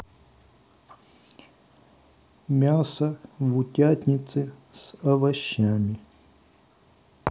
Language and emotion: Russian, neutral